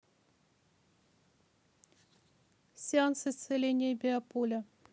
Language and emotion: Russian, neutral